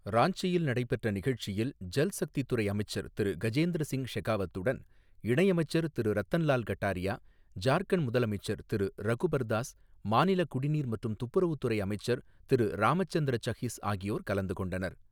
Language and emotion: Tamil, neutral